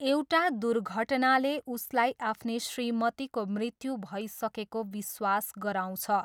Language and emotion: Nepali, neutral